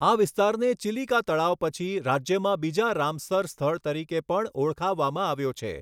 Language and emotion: Gujarati, neutral